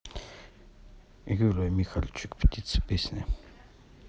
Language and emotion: Russian, neutral